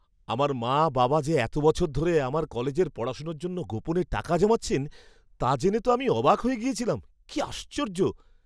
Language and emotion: Bengali, surprised